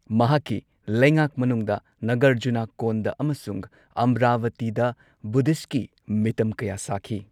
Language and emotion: Manipuri, neutral